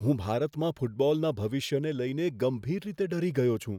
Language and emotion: Gujarati, fearful